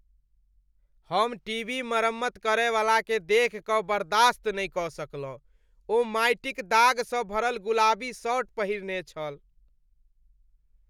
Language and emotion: Maithili, disgusted